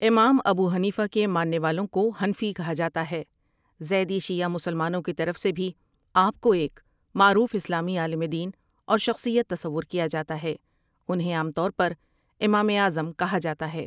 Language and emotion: Urdu, neutral